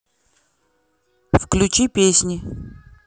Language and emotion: Russian, neutral